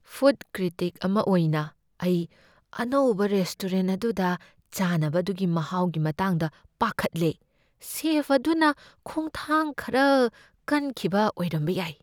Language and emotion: Manipuri, fearful